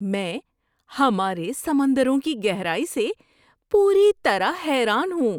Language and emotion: Urdu, surprised